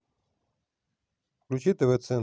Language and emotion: Russian, neutral